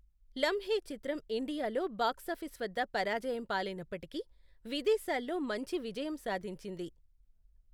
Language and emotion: Telugu, neutral